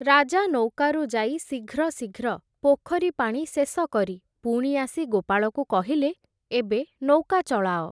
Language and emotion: Odia, neutral